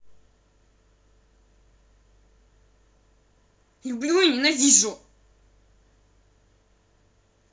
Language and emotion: Russian, angry